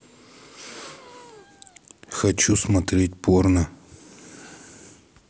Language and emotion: Russian, neutral